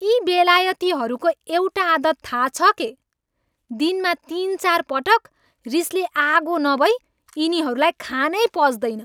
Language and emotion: Nepali, angry